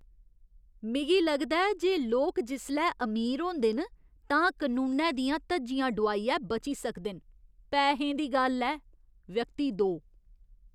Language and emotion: Dogri, disgusted